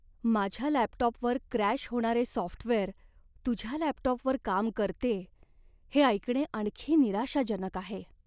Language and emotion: Marathi, sad